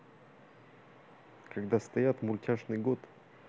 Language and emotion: Russian, neutral